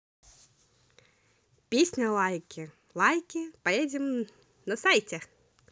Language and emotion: Russian, positive